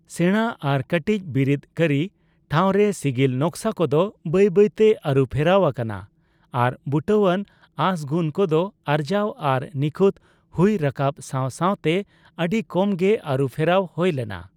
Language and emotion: Santali, neutral